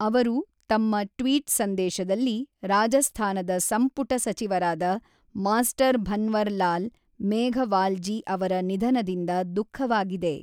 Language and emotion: Kannada, neutral